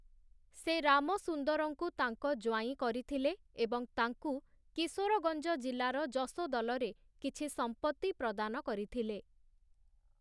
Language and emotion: Odia, neutral